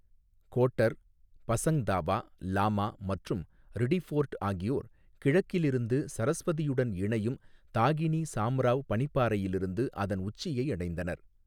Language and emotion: Tamil, neutral